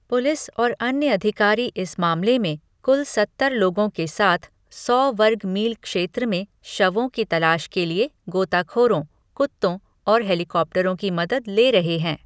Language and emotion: Hindi, neutral